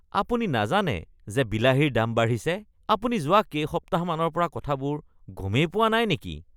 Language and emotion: Assamese, disgusted